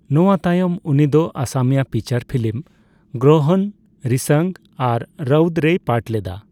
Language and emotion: Santali, neutral